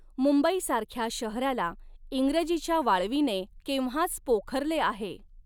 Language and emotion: Marathi, neutral